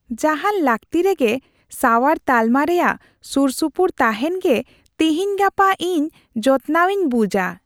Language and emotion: Santali, happy